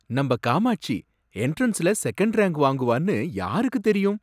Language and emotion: Tamil, surprised